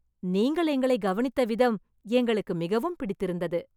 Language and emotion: Tamil, happy